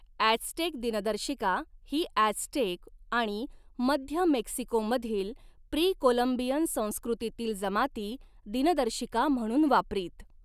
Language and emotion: Marathi, neutral